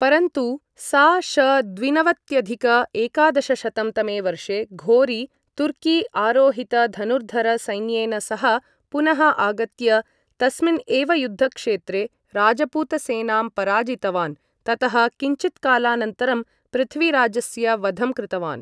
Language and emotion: Sanskrit, neutral